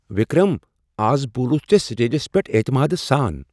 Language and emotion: Kashmiri, surprised